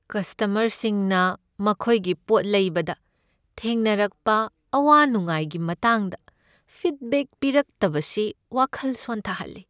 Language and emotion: Manipuri, sad